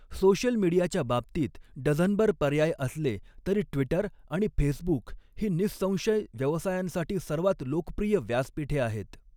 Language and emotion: Marathi, neutral